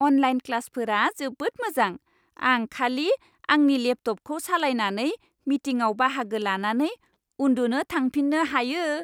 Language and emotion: Bodo, happy